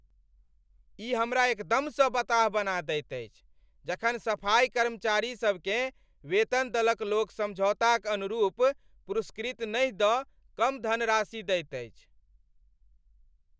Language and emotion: Maithili, angry